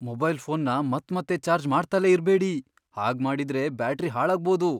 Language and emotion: Kannada, fearful